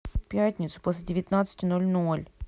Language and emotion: Russian, sad